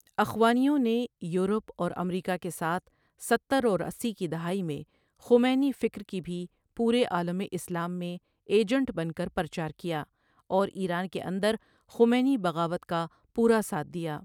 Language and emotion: Urdu, neutral